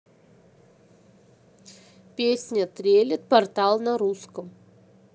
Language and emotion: Russian, neutral